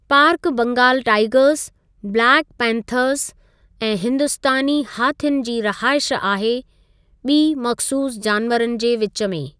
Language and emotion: Sindhi, neutral